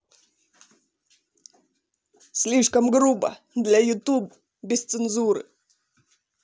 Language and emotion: Russian, angry